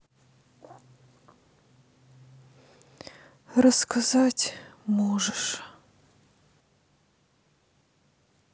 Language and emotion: Russian, sad